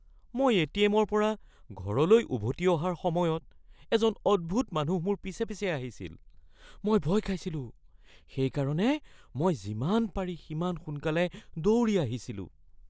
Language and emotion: Assamese, fearful